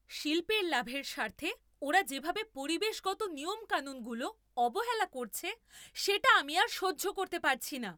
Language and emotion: Bengali, angry